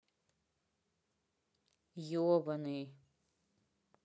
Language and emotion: Russian, neutral